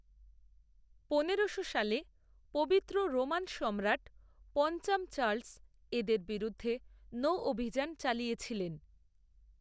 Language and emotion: Bengali, neutral